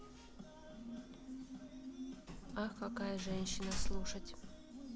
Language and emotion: Russian, neutral